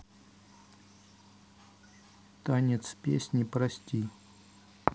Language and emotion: Russian, neutral